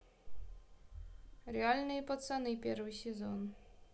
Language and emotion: Russian, neutral